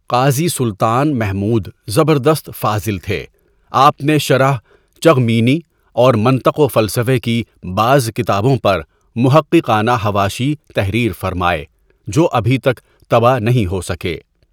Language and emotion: Urdu, neutral